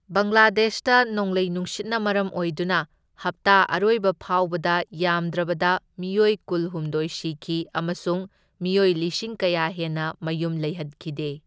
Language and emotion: Manipuri, neutral